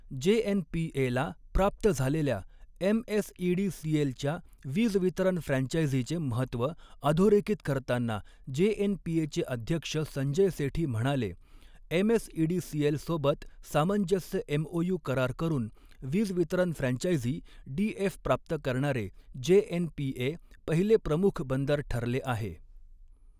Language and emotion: Marathi, neutral